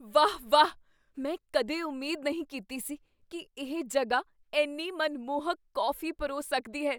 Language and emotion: Punjabi, surprised